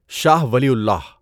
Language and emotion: Urdu, neutral